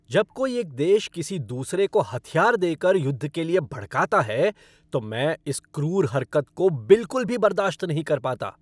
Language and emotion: Hindi, angry